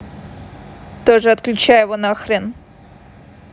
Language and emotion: Russian, angry